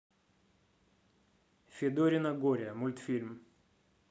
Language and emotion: Russian, neutral